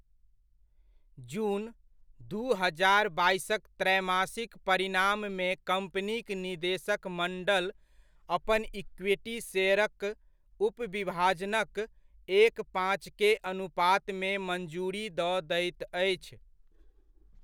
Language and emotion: Maithili, neutral